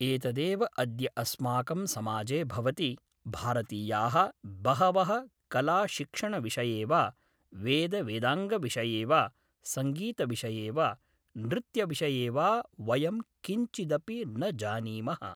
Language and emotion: Sanskrit, neutral